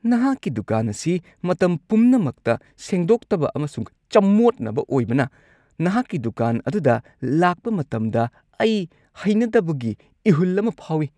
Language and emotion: Manipuri, disgusted